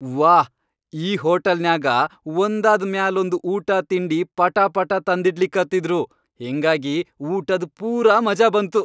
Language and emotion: Kannada, happy